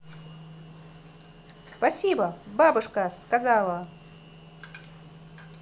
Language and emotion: Russian, positive